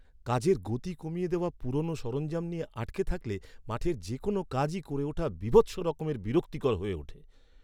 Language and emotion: Bengali, angry